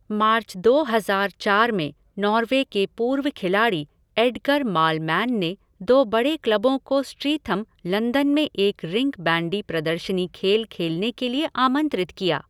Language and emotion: Hindi, neutral